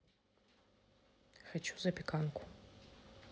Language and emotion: Russian, neutral